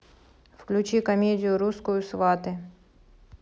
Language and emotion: Russian, neutral